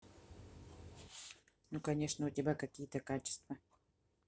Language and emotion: Russian, neutral